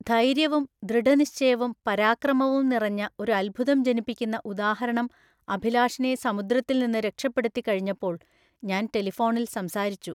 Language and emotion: Malayalam, neutral